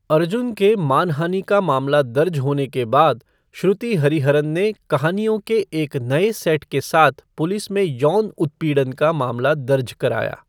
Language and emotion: Hindi, neutral